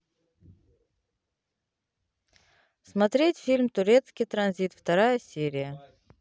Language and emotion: Russian, neutral